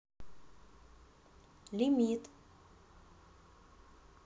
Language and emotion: Russian, neutral